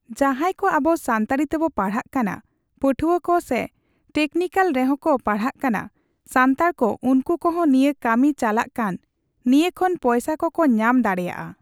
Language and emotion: Santali, neutral